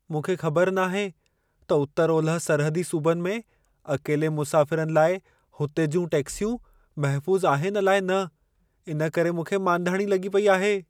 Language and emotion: Sindhi, fearful